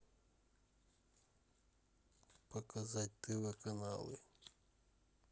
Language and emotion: Russian, neutral